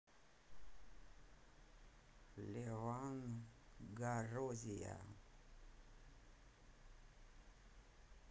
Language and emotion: Russian, neutral